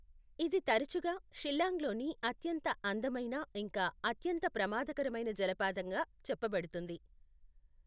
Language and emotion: Telugu, neutral